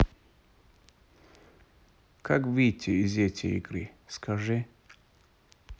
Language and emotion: Russian, neutral